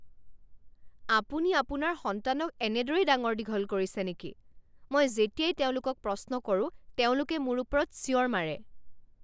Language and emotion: Assamese, angry